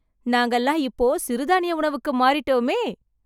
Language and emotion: Tamil, happy